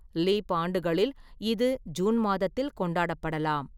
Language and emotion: Tamil, neutral